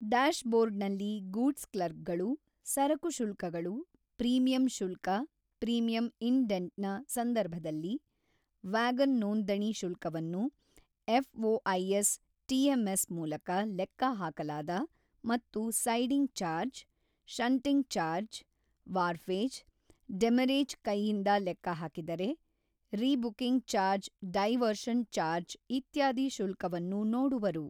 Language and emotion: Kannada, neutral